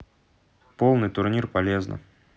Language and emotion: Russian, neutral